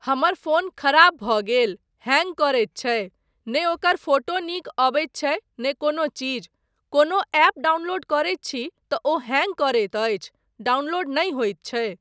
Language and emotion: Maithili, neutral